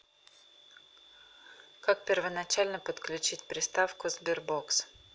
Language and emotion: Russian, neutral